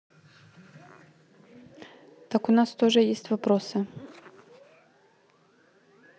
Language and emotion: Russian, neutral